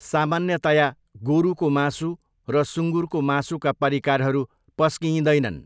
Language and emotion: Nepali, neutral